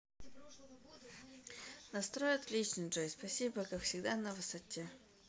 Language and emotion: Russian, neutral